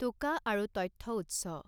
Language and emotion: Assamese, neutral